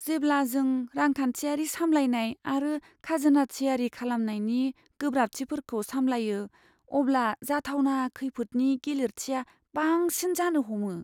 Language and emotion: Bodo, fearful